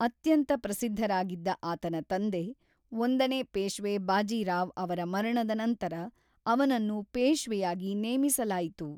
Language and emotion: Kannada, neutral